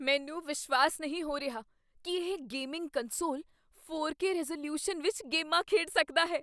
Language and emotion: Punjabi, surprised